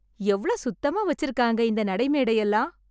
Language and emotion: Tamil, happy